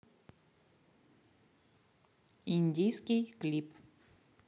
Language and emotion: Russian, neutral